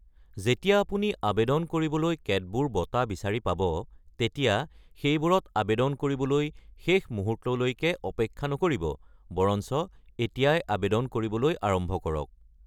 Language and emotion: Assamese, neutral